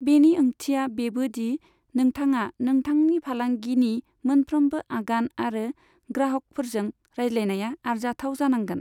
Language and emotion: Bodo, neutral